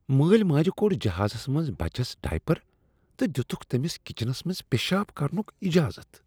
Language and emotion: Kashmiri, disgusted